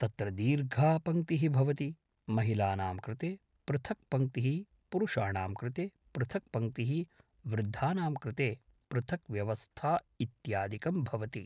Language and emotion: Sanskrit, neutral